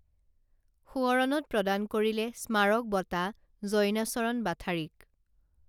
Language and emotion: Assamese, neutral